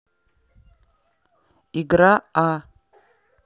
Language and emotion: Russian, neutral